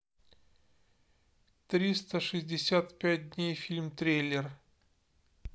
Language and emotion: Russian, neutral